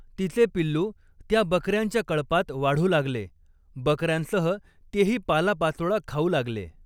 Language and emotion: Marathi, neutral